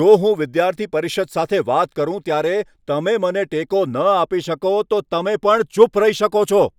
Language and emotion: Gujarati, angry